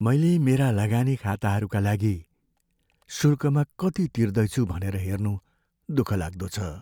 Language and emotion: Nepali, sad